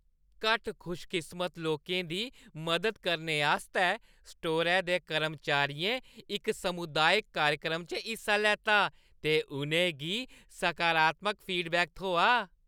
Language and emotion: Dogri, happy